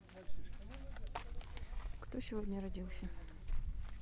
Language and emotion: Russian, neutral